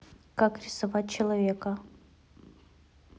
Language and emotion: Russian, neutral